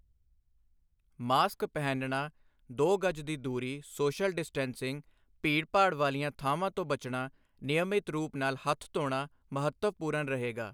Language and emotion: Punjabi, neutral